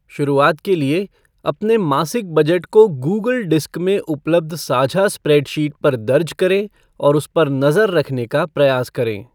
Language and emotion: Hindi, neutral